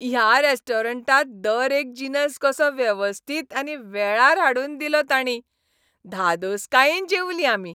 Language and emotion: Goan Konkani, happy